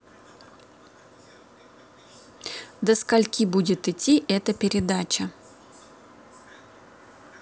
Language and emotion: Russian, neutral